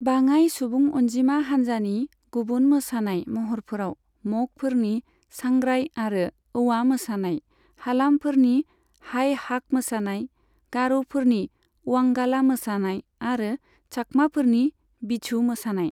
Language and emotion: Bodo, neutral